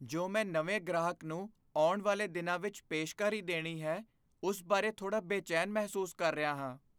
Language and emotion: Punjabi, fearful